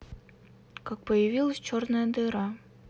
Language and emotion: Russian, neutral